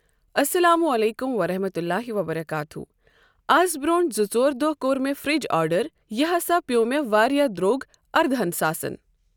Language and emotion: Kashmiri, neutral